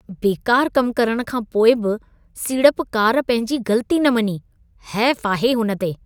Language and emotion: Sindhi, disgusted